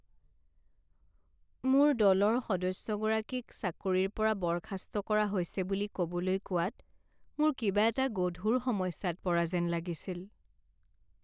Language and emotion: Assamese, sad